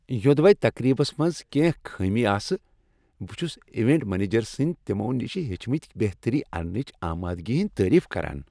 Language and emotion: Kashmiri, happy